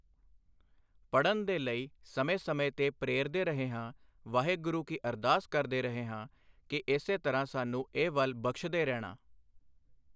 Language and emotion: Punjabi, neutral